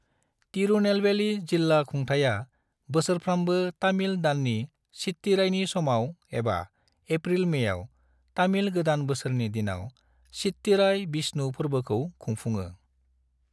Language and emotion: Bodo, neutral